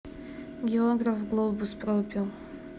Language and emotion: Russian, neutral